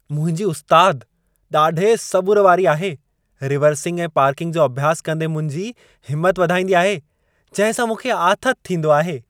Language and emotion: Sindhi, happy